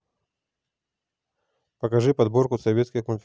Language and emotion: Russian, neutral